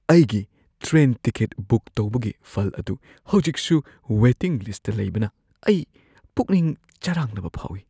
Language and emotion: Manipuri, fearful